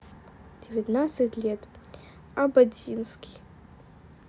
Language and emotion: Russian, neutral